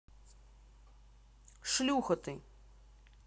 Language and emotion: Russian, angry